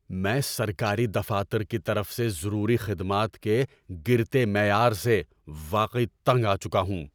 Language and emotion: Urdu, angry